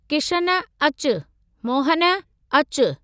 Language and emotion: Sindhi, neutral